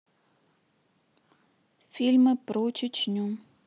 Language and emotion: Russian, neutral